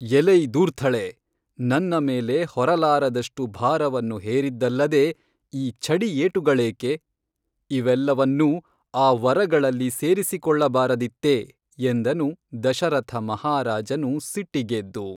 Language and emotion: Kannada, neutral